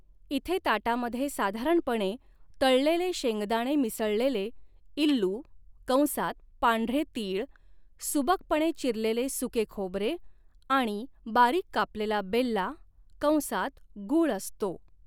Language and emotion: Marathi, neutral